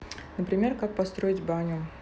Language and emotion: Russian, neutral